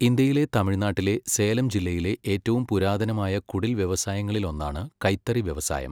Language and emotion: Malayalam, neutral